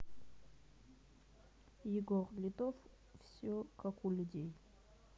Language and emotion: Russian, neutral